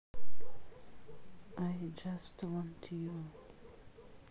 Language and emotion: Russian, neutral